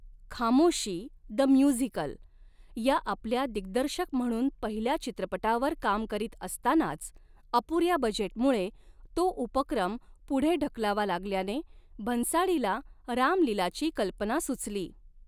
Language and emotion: Marathi, neutral